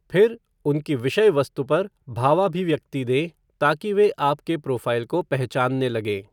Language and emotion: Hindi, neutral